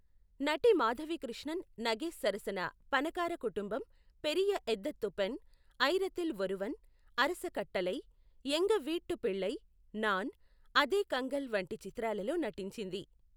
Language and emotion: Telugu, neutral